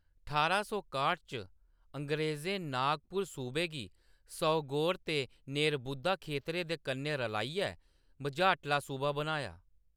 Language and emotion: Dogri, neutral